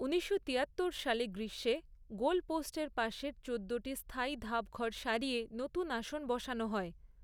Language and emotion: Bengali, neutral